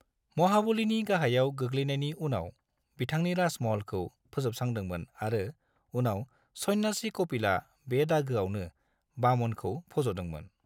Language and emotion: Bodo, neutral